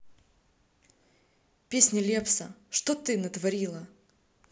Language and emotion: Russian, neutral